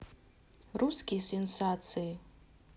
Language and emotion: Russian, neutral